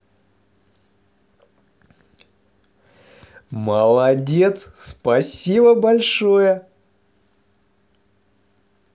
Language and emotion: Russian, positive